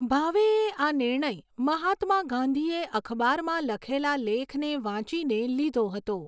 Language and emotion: Gujarati, neutral